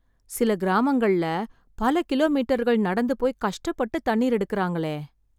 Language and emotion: Tamil, sad